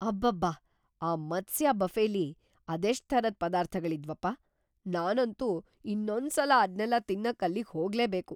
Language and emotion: Kannada, surprised